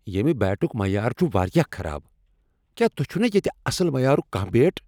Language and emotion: Kashmiri, angry